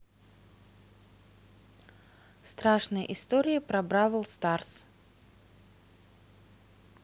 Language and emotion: Russian, neutral